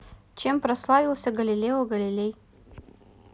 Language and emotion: Russian, neutral